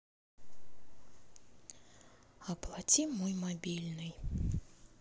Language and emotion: Russian, neutral